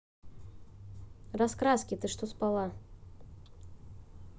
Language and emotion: Russian, neutral